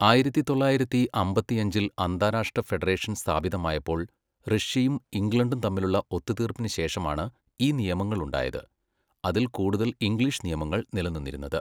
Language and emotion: Malayalam, neutral